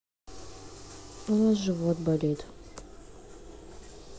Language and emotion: Russian, sad